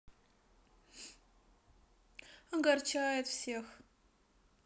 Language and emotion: Russian, sad